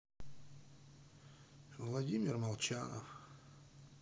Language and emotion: Russian, sad